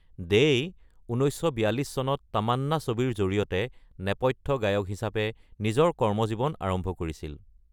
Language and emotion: Assamese, neutral